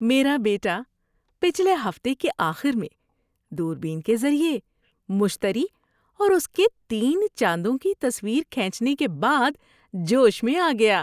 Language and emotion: Urdu, happy